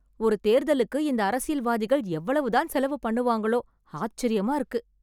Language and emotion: Tamil, surprised